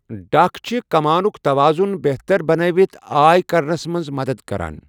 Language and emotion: Kashmiri, neutral